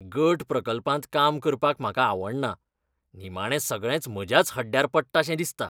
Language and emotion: Goan Konkani, disgusted